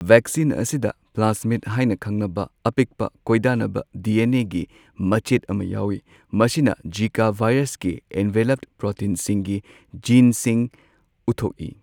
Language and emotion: Manipuri, neutral